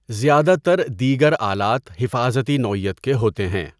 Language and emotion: Urdu, neutral